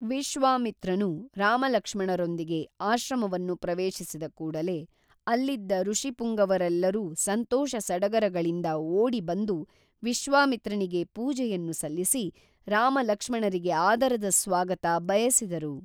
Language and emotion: Kannada, neutral